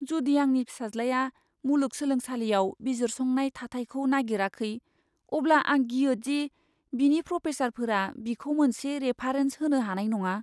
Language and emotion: Bodo, fearful